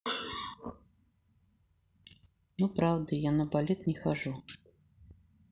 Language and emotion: Russian, neutral